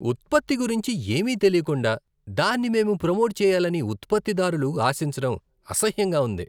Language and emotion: Telugu, disgusted